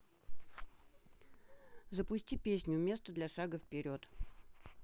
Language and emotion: Russian, neutral